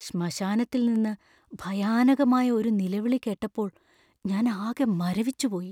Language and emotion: Malayalam, fearful